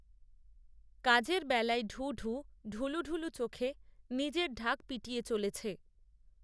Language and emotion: Bengali, neutral